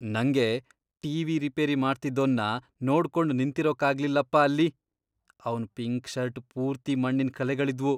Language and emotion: Kannada, disgusted